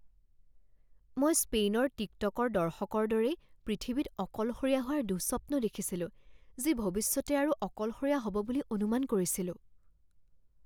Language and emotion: Assamese, fearful